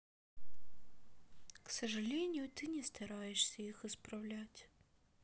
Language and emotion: Russian, sad